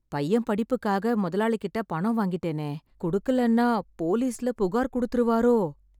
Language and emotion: Tamil, fearful